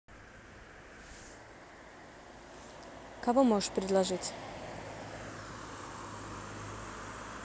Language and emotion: Russian, neutral